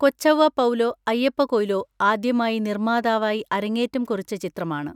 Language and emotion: Malayalam, neutral